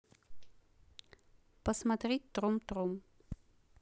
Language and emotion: Russian, neutral